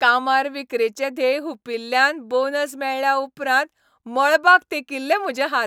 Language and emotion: Goan Konkani, happy